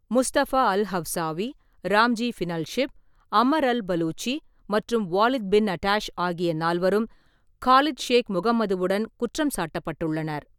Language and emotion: Tamil, neutral